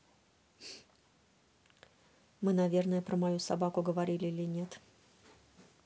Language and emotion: Russian, neutral